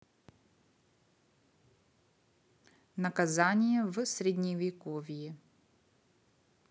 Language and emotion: Russian, neutral